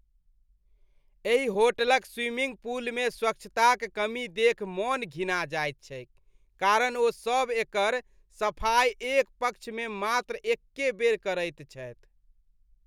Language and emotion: Maithili, disgusted